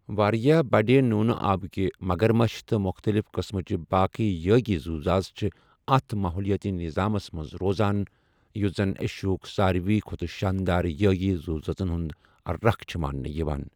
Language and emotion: Kashmiri, neutral